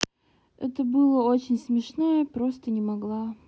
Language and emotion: Russian, neutral